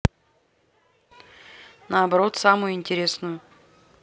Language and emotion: Russian, neutral